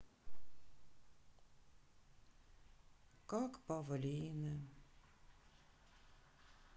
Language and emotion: Russian, sad